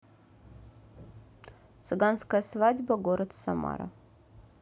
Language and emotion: Russian, neutral